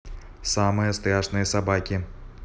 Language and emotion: Russian, neutral